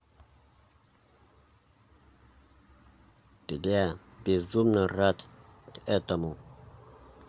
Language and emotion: Russian, neutral